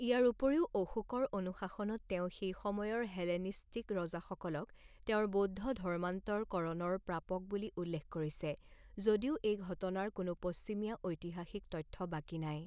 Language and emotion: Assamese, neutral